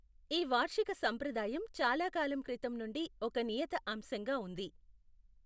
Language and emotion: Telugu, neutral